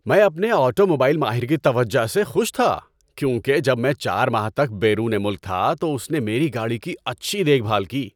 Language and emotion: Urdu, happy